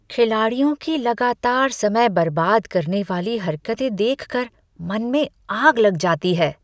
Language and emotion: Hindi, disgusted